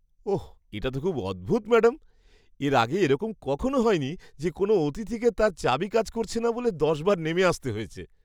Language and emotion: Bengali, surprised